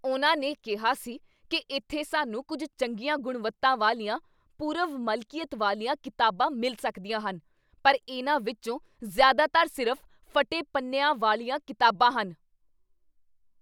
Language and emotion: Punjabi, angry